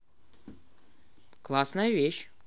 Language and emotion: Russian, positive